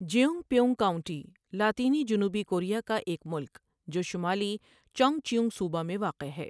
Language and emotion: Urdu, neutral